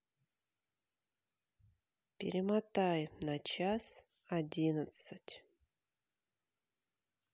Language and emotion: Russian, neutral